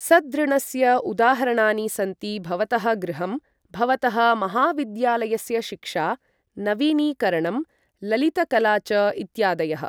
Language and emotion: Sanskrit, neutral